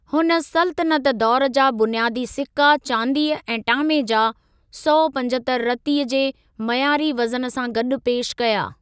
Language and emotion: Sindhi, neutral